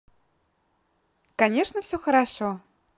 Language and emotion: Russian, positive